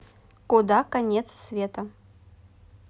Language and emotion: Russian, neutral